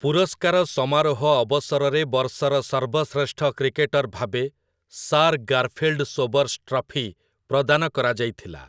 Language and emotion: Odia, neutral